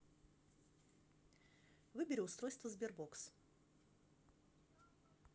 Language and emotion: Russian, neutral